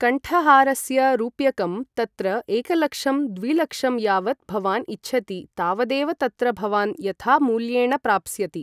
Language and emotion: Sanskrit, neutral